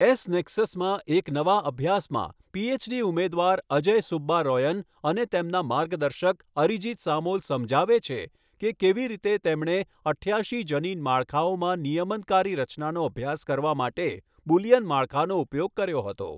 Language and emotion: Gujarati, neutral